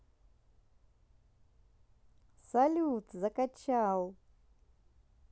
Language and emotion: Russian, positive